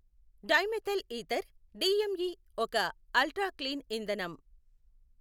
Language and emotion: Telugu, neutral